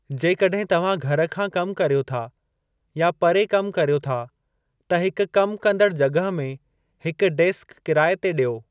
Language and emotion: Sindhi, neutral